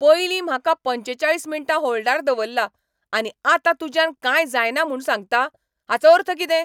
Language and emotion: Goan Konkani, angry